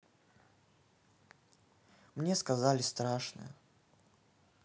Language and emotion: Russian, sad